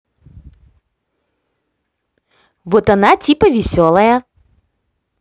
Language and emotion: Russian, positive